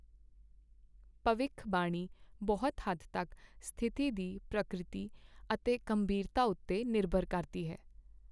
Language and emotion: Punjabi, neutral